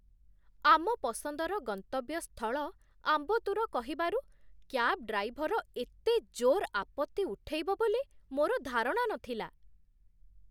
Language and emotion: Odia, surprised